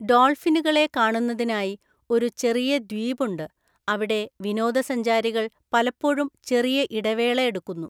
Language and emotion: Malayalam, neutral